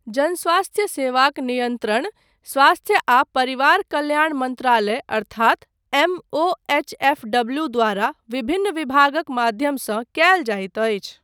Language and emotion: Maithili, neutral